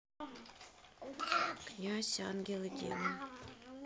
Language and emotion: Russian, neutral